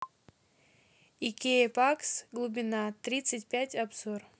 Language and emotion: Russian, neutral